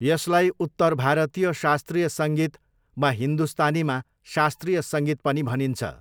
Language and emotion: Nepali, neutral